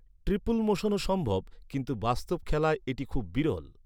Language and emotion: Bengali, neutral